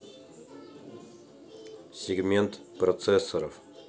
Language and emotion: Russian, neutral